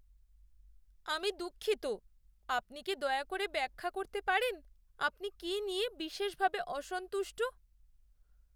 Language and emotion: Bengali, sad